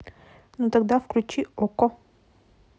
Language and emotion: Russian, neutral